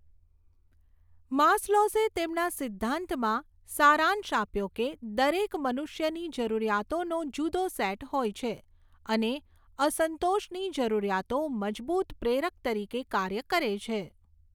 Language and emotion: Gujarati, neutral